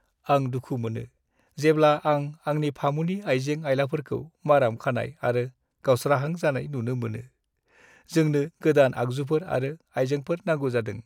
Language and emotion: Bodo, sad